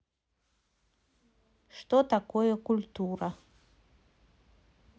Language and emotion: Russian, neutral